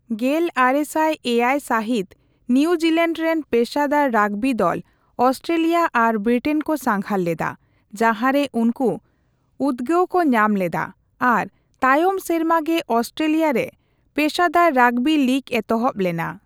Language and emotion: Santali, neutral